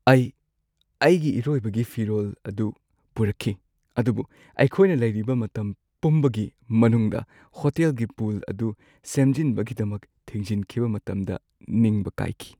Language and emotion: Manipuri, sad